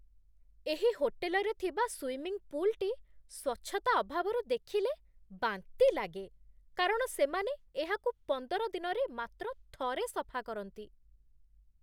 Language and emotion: Odia, disgusted